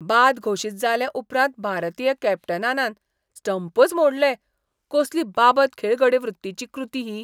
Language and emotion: Goan Konkani, disgusted